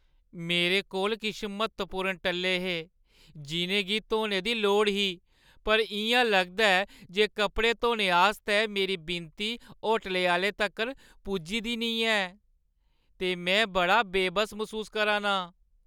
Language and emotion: Dogri, sad